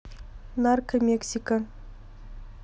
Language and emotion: Russian, neutral